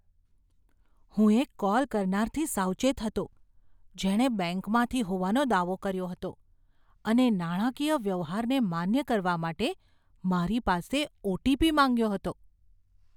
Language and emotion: Gujarati, fearful